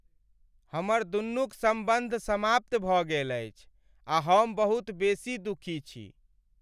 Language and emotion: Maithili, sad